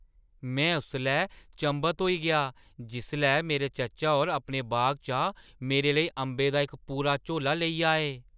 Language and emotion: Dogri, surprised